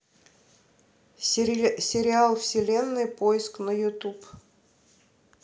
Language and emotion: Russian, neutral